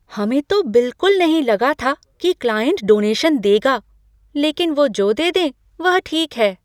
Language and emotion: Hindi, surprised